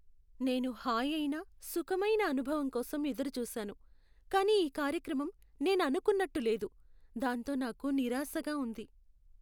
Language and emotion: Telugu, sad